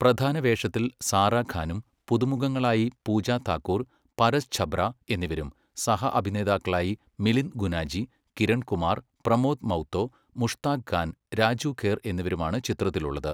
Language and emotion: Malayalam, neutral